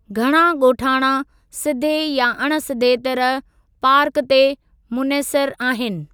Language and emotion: Sindhi, neutral